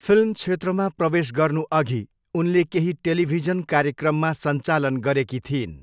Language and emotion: Nepali, neutral